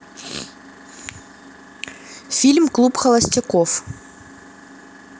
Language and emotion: Russian, neutral